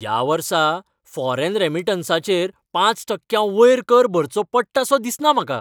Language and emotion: Goan Konkani, happy